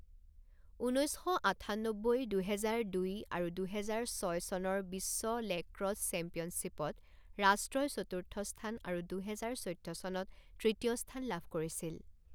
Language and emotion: Assamese, neutral